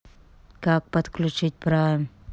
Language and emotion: Russian, neutral